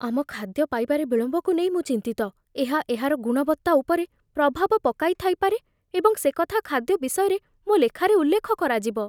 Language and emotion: Odia, fearful